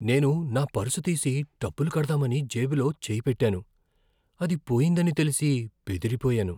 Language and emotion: Telugu, fearful